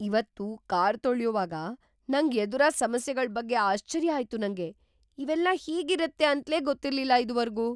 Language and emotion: Kannada, surprised